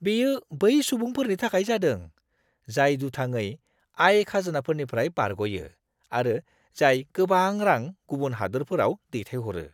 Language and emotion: Bodo, disgusted